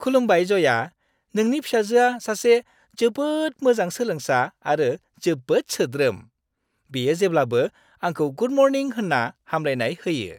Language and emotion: Bodo, happy